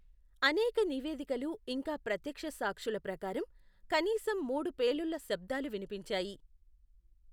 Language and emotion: Telugu, neutral